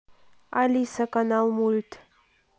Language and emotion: Russian, neutral